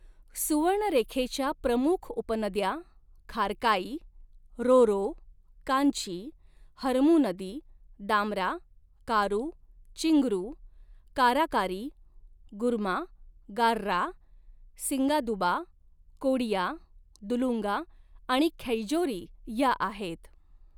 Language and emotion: Marathi, neutral